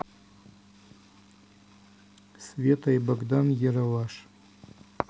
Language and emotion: Russian, neutral